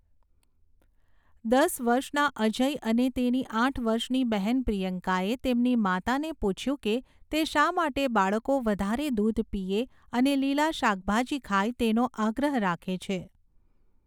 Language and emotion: Gujarati, neutral